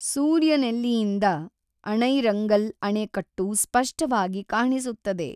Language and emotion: Kannada, neutral